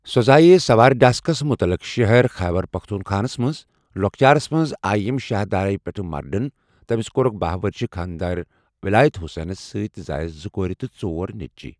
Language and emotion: Kashmiri, neutral